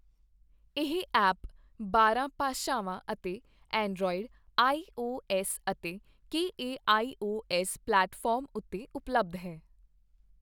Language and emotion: Punjabi, neutral